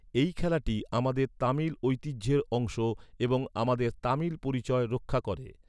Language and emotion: Bengali, neutral